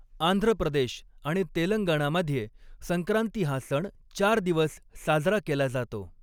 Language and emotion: Marathi, neutral